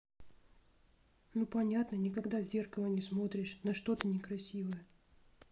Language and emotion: Russian, neutral